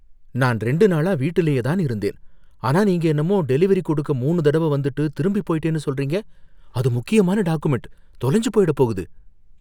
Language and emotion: Tamil, fearful